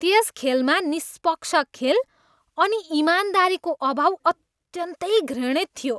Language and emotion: Nepali, disgusted